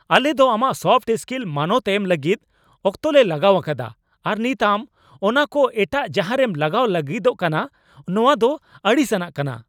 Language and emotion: Santali, angry